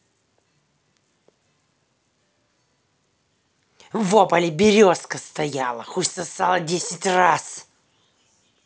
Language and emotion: Russian, angry